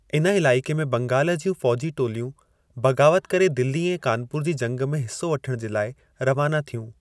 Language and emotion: Sindhi, neutral